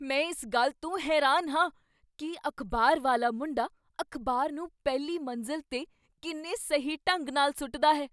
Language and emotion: Punjabi, surprised